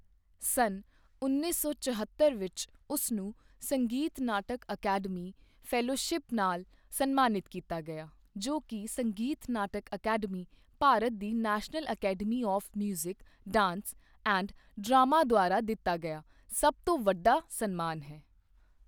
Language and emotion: Punjabi, neutral